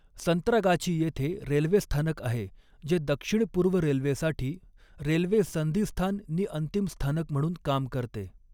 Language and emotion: Marathi, neutral